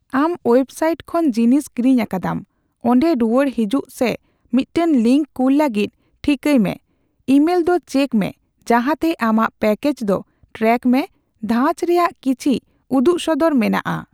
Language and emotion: Santali, neutral